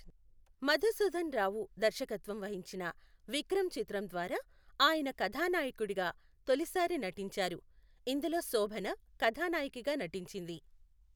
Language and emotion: Telugu, neutral